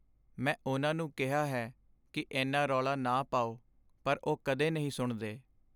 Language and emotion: Punjabi, sad